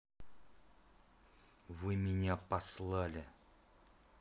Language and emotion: Russian, angry